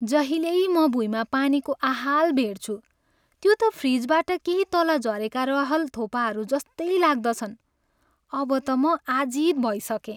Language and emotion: Nepali, sad